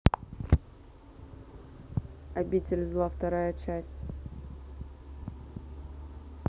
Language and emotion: Russian, neutral